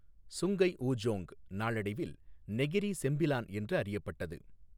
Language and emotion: Tamil, neutral